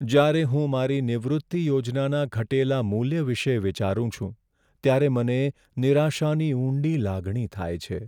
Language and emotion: Gujarati, sad